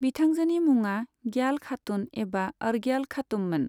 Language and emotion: Bodo, neutral